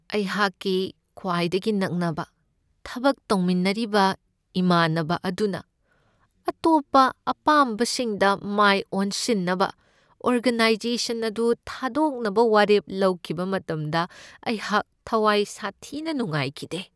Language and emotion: Manipuri, sad